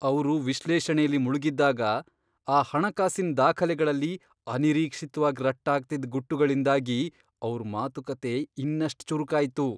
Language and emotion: Kannada, surprised